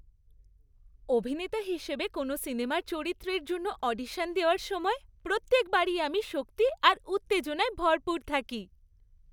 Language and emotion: Bengali, happy